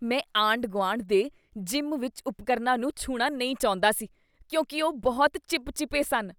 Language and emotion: Punjabi, disgusted